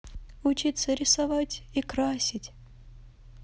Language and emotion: Russian, neutral